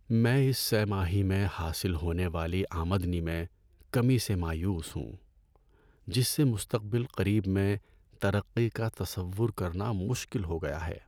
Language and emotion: Urdu, sad